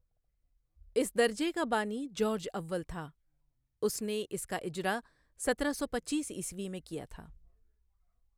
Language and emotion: Urdu, neutral